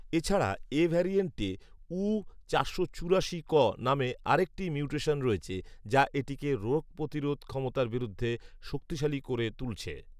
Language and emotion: Bengali, neutral